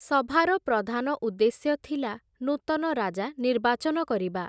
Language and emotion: Odia, neutral